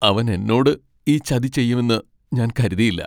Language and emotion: Malayalam, sad